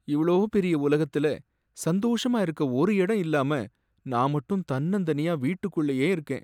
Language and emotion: Tamil, sad